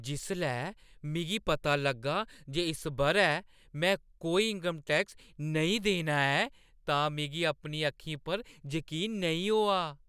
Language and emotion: Dogri, surprised